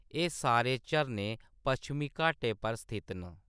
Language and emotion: Dogri, neutral